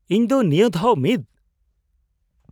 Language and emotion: Santali, surprised